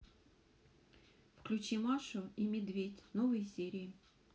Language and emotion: Russian, neutral